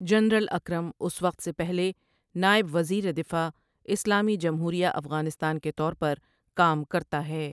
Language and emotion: Urdu, neutral